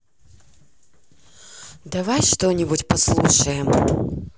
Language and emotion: Russian, neutral